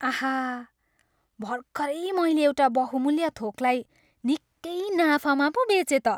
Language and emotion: Nepali, happy